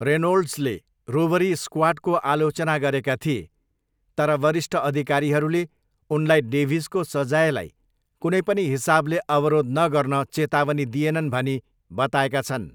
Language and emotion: Nepali, neutral